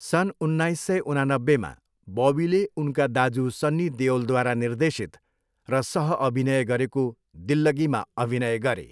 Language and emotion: Nepali, neutral